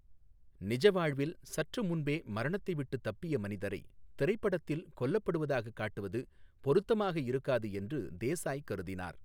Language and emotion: Tamil, neutral